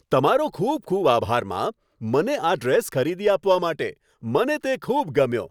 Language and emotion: Gujarati, happy